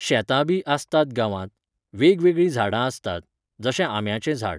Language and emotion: Goan Konkani, neutral